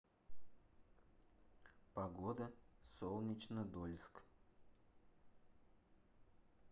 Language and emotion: Russian, neutral